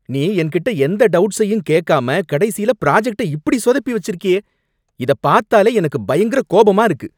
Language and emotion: Tamil, angry